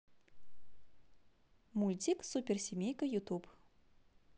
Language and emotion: Russian, positive